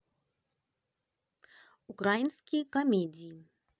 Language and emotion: Russian, positive